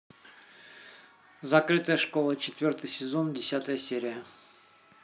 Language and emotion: Russian, neutral